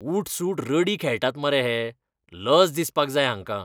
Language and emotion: Goan Konkani, disgusted